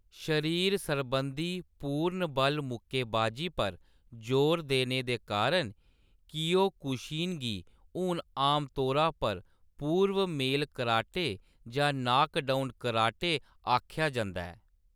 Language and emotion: Dogri, neutral